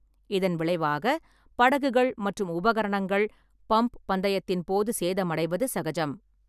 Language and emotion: Tamil, neutral